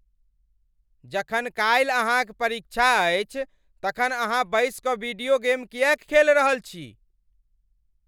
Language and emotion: Maithili, angry